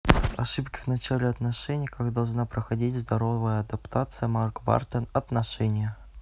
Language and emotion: Russian, neutral